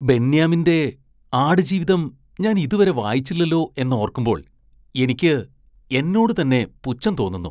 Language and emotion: Malayalam, disgusted